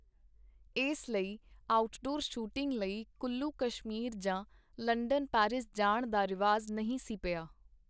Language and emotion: Punjabi, neutral